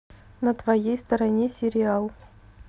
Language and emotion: Russian, neutral